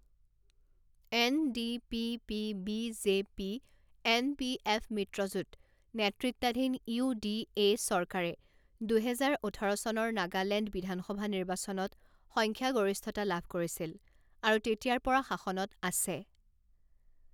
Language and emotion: Assamese, neutral